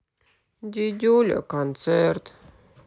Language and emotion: Russian, sad